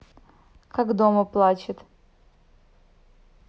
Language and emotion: Russian, neutral